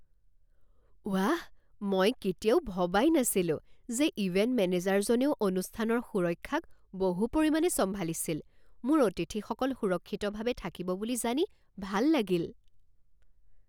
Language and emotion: Assamese, surprised